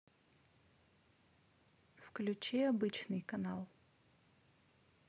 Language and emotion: Russian, neutral